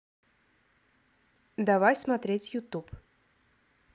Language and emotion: Russian, neutral